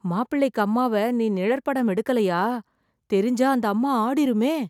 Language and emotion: Tamil, fearful